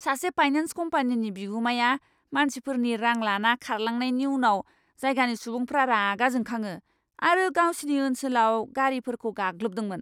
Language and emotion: Bodo, angry